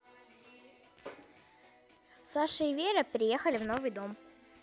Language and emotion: Russian, neutral